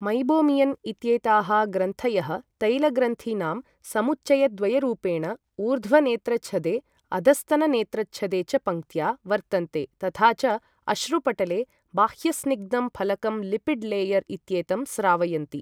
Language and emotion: Sanskrit, neutral